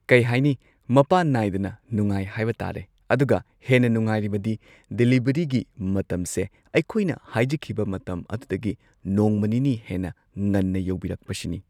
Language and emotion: Manipuri, neutral